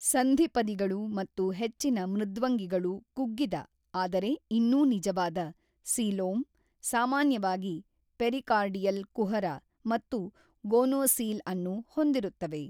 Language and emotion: Kannada, neutral